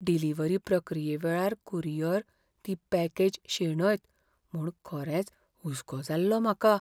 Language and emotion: Goan Konkani, fearful